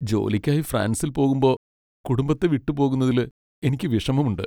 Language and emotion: Malayalam, sad